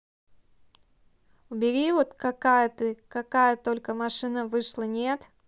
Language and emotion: Russian, neutral